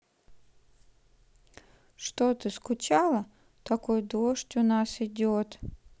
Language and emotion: Russian, sad